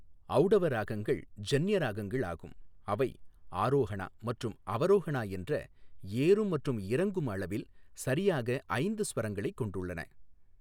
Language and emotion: Tamil, neutral